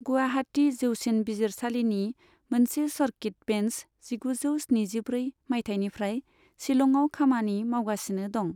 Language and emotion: Bodo, neutral